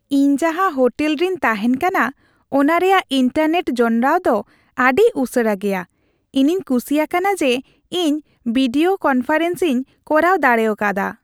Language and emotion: Santali, happy